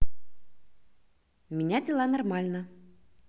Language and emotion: Russian, positive